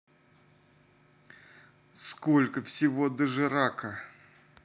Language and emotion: Russian, angry